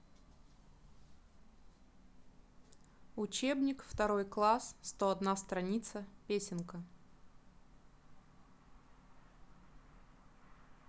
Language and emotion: Russian, neutral